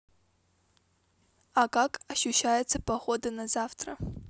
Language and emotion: Russian, neutral